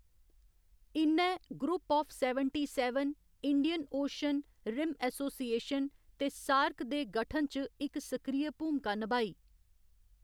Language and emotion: Dogri, neutral